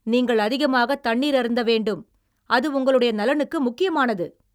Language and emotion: Tamil, angry